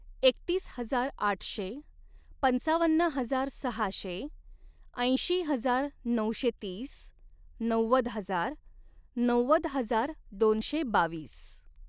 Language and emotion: Marathi, neutral